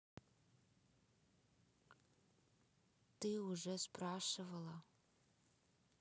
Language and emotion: Russian, neutral